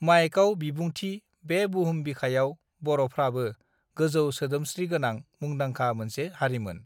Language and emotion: Bodo, neutral